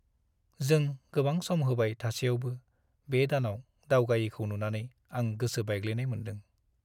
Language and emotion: Bodo, sad